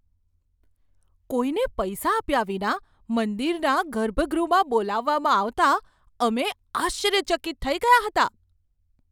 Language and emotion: Gujarati, surprised